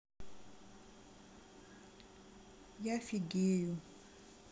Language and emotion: Russian, sad